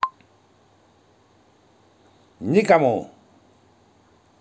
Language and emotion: Russian, angry